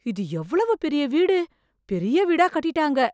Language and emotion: Tamil, surprised